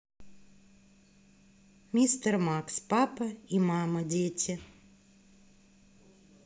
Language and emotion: Russian, neutral